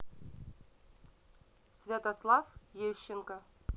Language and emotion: Russian, neutral